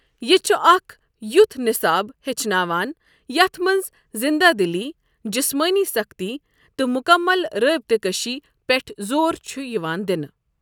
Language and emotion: Kashmiri, neutral